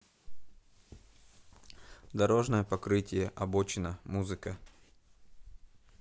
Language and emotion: Russian, neutral